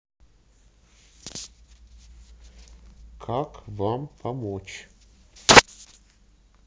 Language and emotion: Russian, neutral